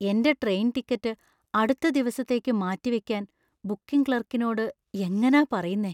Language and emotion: Malayalam, fearful